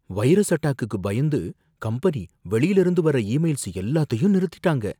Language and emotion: Tamil, fearful